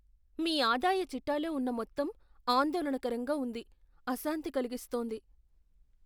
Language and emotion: Telugu, fearful